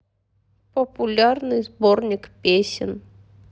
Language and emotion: Russian, sad